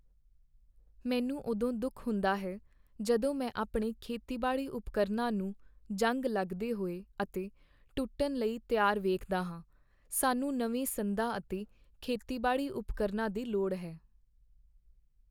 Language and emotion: Punjabi, sad